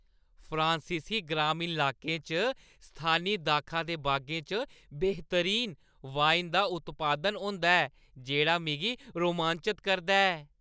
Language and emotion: Dogri, happy